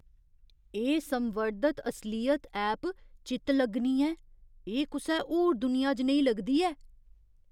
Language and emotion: Dogri, surprised